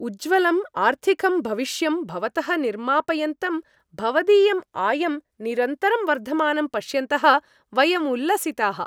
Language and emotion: Sanskrit, happy